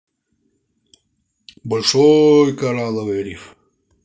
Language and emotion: Russian, positive